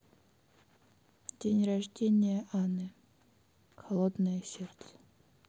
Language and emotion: Russian, neutral